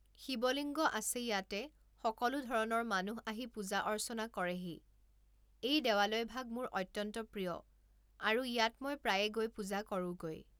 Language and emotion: Assamese, neutral